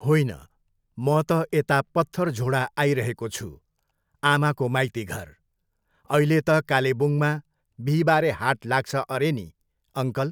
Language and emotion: Nepali, neutral